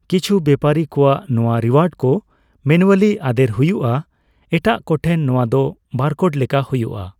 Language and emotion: Santali, neutral